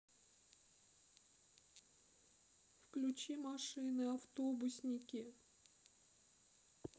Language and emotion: Russian, sad